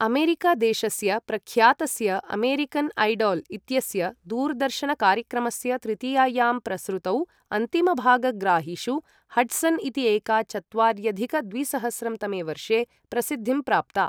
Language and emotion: Sanskrit, neutral